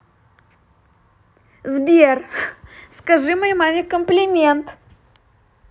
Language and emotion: Russian, positive